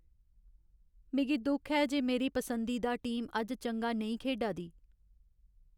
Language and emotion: Dogri, sad